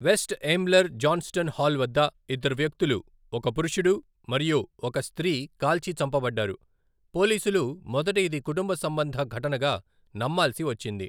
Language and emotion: Telugu, neutral